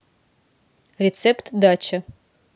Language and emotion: Russian, neutral